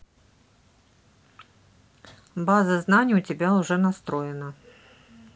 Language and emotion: Russian, neutral